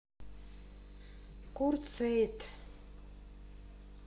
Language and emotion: Russian, neutral